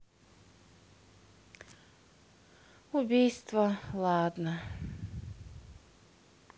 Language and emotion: Russian, sad